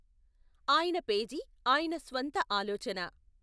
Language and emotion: Telugu, neutral